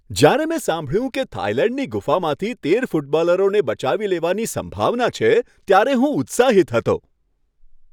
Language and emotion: Gujarati, happy